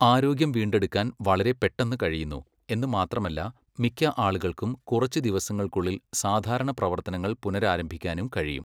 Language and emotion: Malayalam, neutral